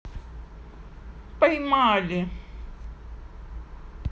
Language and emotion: Russian, positive